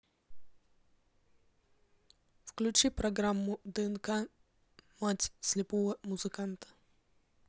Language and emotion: Russian, neutral